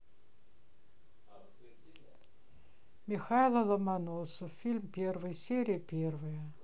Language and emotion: Russian, neutral